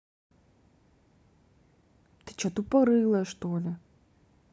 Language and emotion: Russian, angry